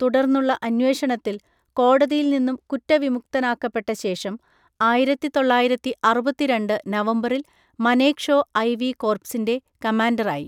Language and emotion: Malayalam, neutral